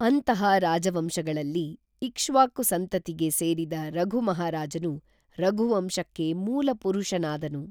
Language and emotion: Kannada, neutral